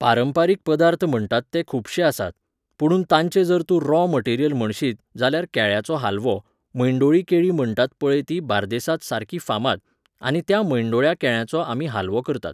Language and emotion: Goan Konkani, neutral